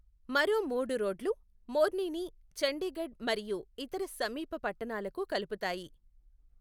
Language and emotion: Telugu, neutral